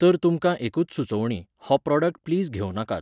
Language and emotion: Goan Konkani, neutral